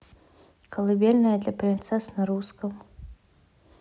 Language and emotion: Russian, neutral